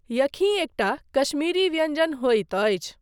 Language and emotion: Maithili, neutral